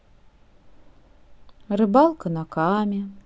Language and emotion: Russian, neutral